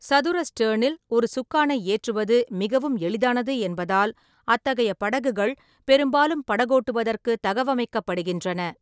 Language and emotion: Tamil, neutral